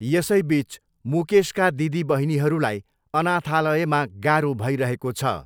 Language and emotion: Nepali, neutral